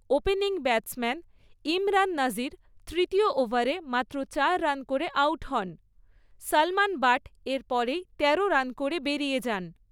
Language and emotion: Bengali, neutral